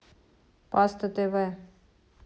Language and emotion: Russian, neutral